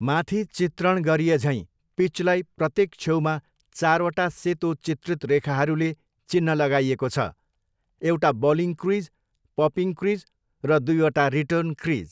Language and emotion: Nepali, neutral